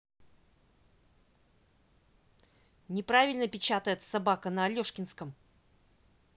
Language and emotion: Russian, angry